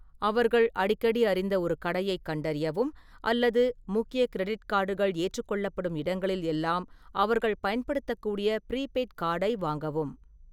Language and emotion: Tamil, neutral